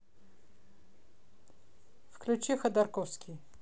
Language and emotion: Russian, neutral